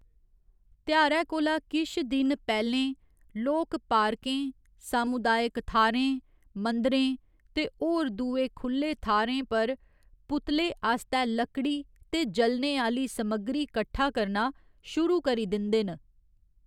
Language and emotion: Dogri, neutral